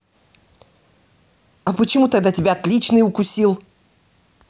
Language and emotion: Russian, angry